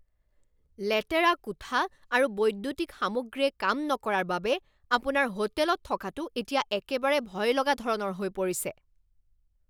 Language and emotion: Assamese, angry